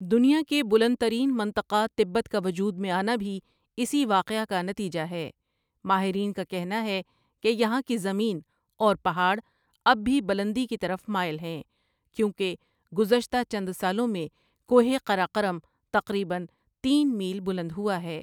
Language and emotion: Urdu, neutral